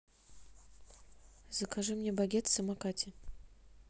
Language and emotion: Russian, neutral